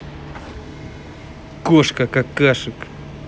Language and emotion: Russian, angry